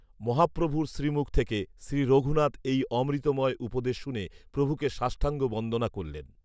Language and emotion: Bengali, neutral